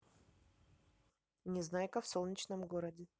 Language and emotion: Russian, neutral